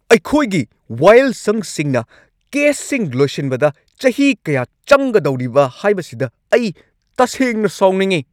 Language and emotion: Manipuri, angry